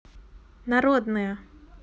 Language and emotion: Russian, neutral